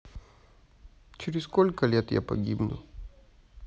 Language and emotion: Russian, sad